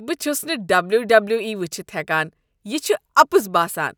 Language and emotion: Kashmiri, disgusted